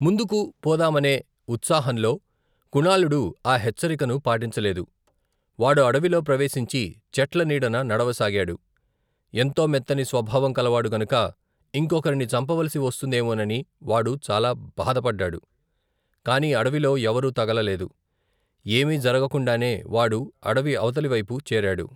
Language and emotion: Telugu, neutral